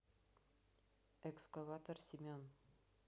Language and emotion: Russian, neutral